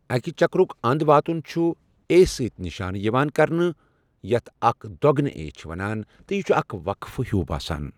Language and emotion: Kashmiri, neutral